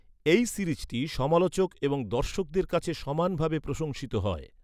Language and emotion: Bengali, neutral